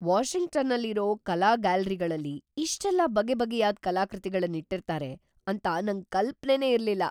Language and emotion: Kannada, surprised